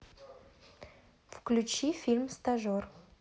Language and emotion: Russian, neutral